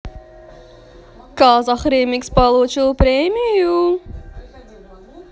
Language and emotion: Russian, positive